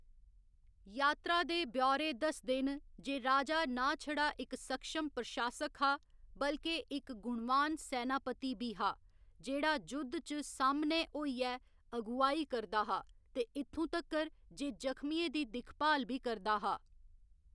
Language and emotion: Dogri, neutral